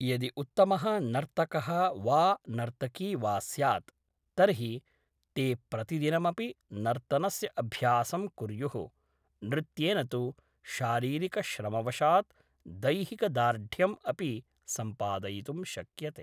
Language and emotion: Sanskrit, neutral